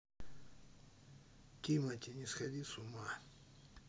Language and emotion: Russian, neutral